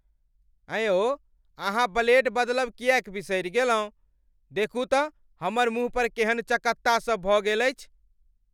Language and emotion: Maithili, angry